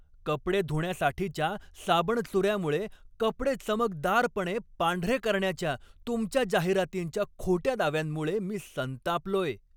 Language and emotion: Marathi, angry